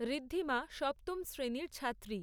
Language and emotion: Bengali, neutral